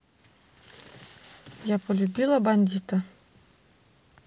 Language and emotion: Russian, neutral